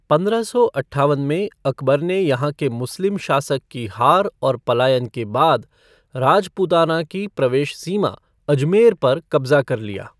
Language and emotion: Hindi, neutral